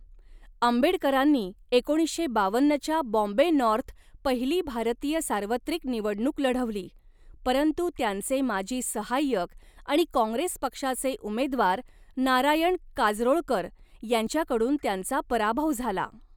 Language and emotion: Marathi, neutral